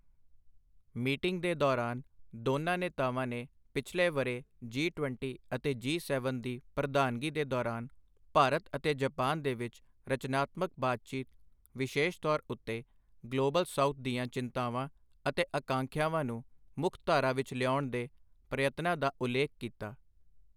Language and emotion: Punjabi, neutral